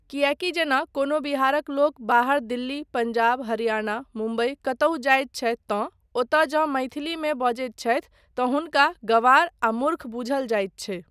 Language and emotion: Maithili, neutral